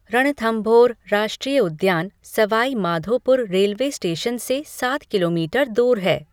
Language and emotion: Hindi, neutral